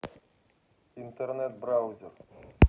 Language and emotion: Russian, neutral